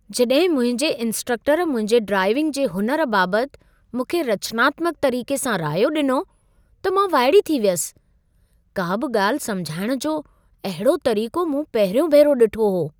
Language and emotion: Sindhi, surprised